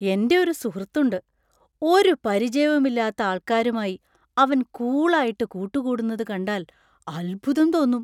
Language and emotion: Malayalam, surprised